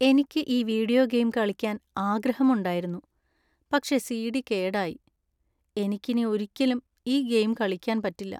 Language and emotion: Malayalam, sad